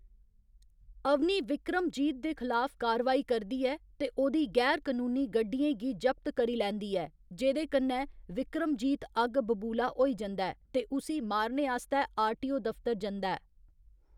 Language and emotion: Dogri, neutral